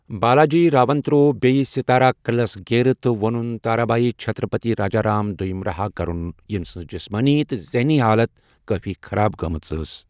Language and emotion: Kashmiri, neutral